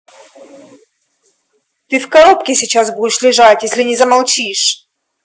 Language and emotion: Russian, angry